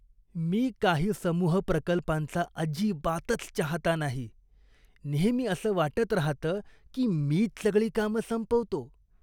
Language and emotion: Marathi, disgusted